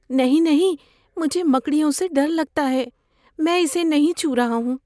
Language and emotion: Urdu, fearful